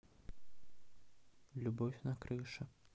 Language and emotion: Russian, neutral